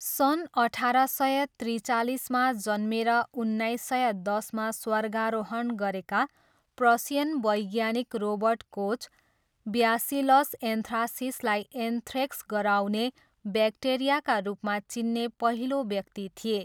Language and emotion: Nepali, neutral